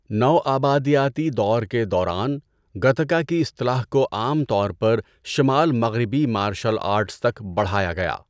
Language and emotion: Urdu, neutral